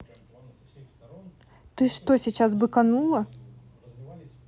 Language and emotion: Russian, angry